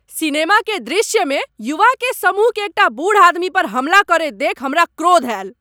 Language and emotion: Maithili, angry